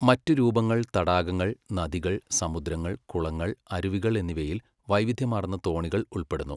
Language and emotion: Malayalam, neutral